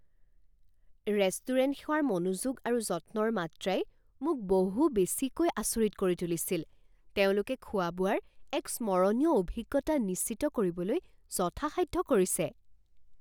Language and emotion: Assamese, surprised